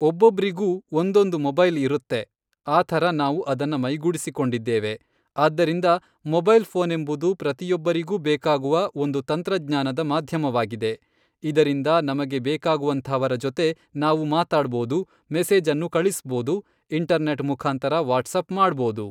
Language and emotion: Kannada, neutral